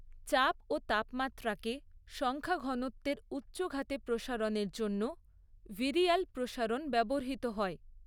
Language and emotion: Bengali, neutral